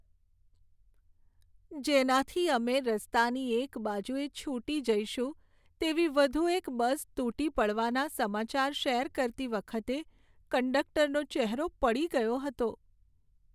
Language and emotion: Gujarati, sad